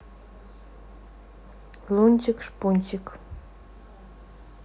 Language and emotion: Russian, neutral